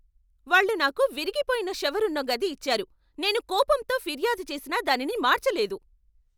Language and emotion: Telugu, angry